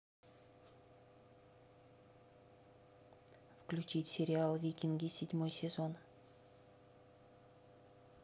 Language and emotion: Russian, neutral